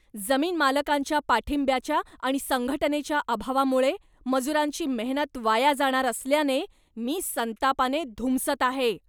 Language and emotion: Marathi, angry